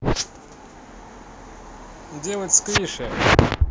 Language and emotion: Russian, neutral